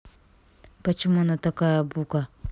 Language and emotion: Russian, neutral